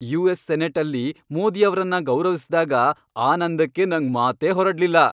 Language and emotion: Kannada, happy